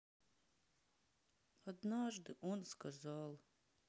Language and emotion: Russian, sad